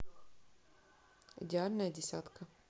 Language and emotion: Russian, neutral